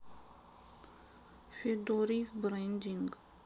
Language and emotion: Russian, sad